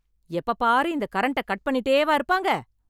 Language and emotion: Tamil, angry